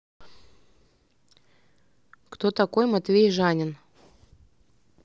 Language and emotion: Russian, neutral